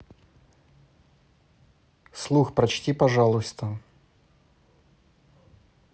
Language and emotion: Russian, neutral